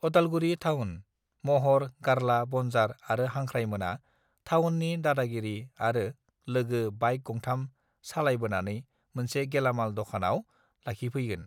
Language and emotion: Bodo, neutral